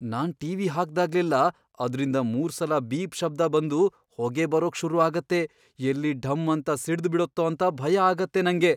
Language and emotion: Kannada, fearful